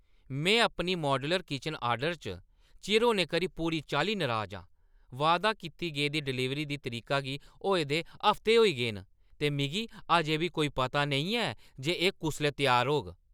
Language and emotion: Dogri, angry